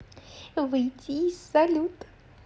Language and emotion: Russian, positive